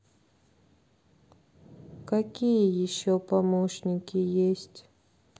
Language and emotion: Russian, neutral